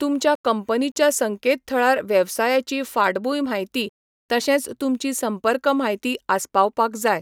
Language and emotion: Goan Konkani, neutral